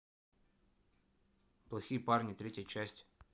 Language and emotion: Russian, neutral